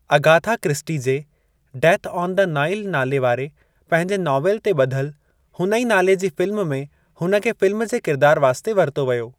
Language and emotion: Sindhi, neutral